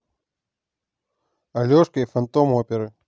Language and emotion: Russian, neutral